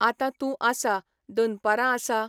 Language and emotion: Goan Konkani, neutral